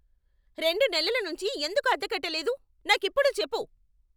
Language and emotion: Telugu, angry